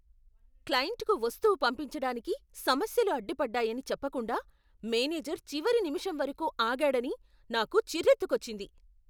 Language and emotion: Telugu, angry